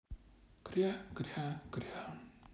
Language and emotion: Russian, sad